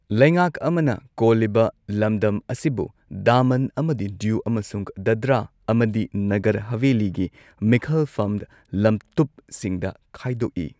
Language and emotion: Manipuri, neutral